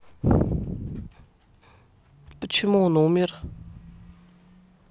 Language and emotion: Russian, neutral